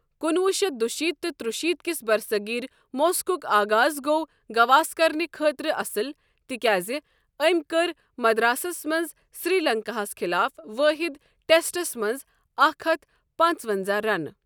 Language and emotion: Kashmiri, neutral